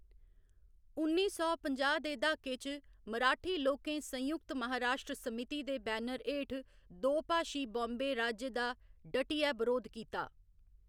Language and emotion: Dogri, neutral